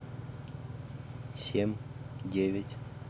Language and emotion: Russian, neutral